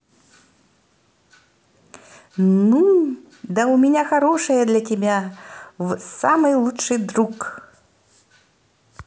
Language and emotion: Russian, positive